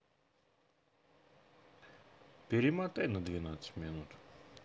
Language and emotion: Russian, neutral